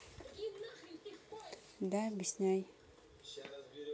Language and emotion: Russian, neutral